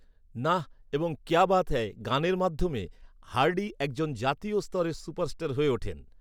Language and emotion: Bengali, neutral